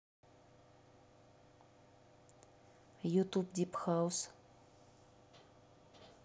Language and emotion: Russian, neutral